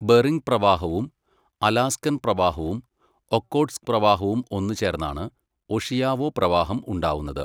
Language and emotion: Malayalam, neutral